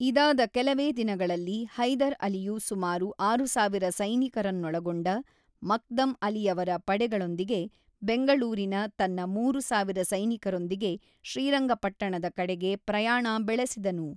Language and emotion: Kannada, neutral